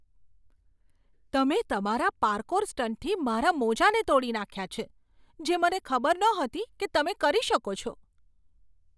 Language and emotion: Gujarati, surprised